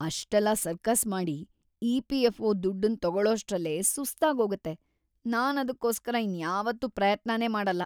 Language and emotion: Kannada, disgusted